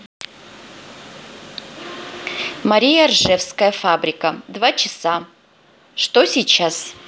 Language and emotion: Russian, neutral